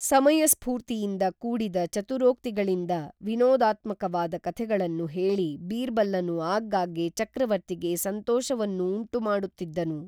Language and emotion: Kannada, neutral